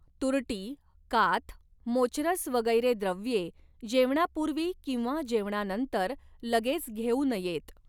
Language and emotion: Marathi, neutral